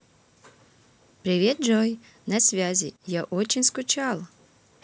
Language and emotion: Russian, positive